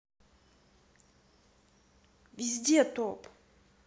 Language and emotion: Russian, angry